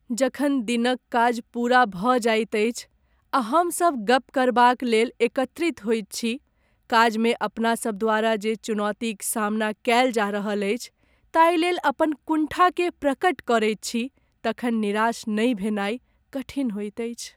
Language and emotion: Maithili, sad